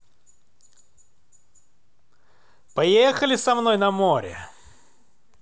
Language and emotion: Russian, positive